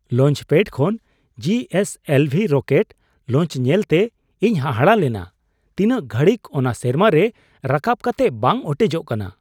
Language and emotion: Santali, surprised